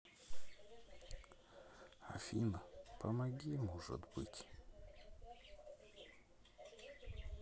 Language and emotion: Russian, sad